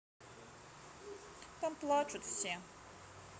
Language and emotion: Russian, sad